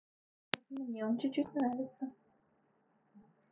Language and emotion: Russian, neutral